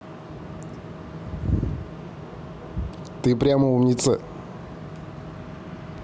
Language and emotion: Russian, neutral